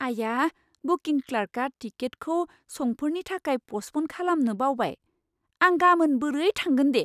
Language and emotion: Bodo, surprised